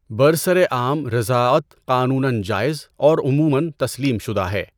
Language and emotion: Urdu, neutral